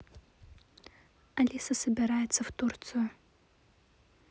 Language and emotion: Russian, neutral